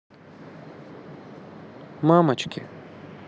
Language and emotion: Russian, neutral